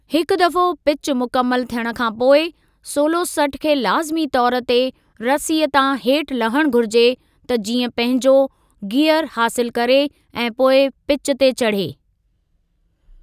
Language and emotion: Sindhi, neutral